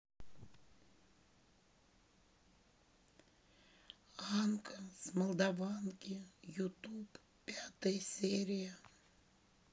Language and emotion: Russian, sad